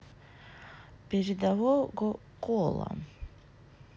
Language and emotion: Russian, neutral